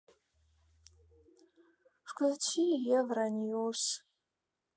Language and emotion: Russian, sad